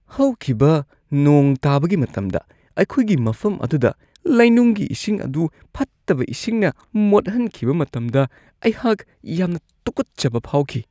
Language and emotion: Manipuri, disgusted